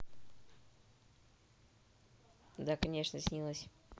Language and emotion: Russian, neutral